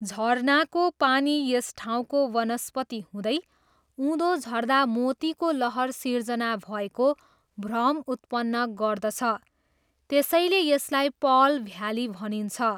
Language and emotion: Nepali, neutral